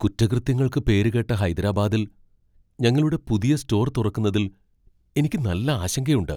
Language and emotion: Malayalam, fearful